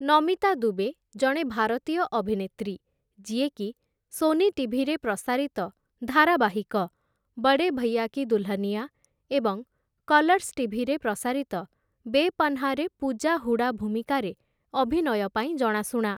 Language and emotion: Odia, neutral